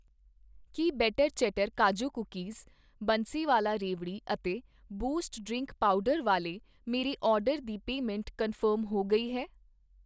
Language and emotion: Punjabi, neutral